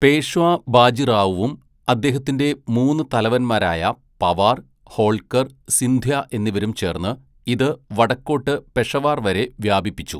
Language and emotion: Malayalam, neutral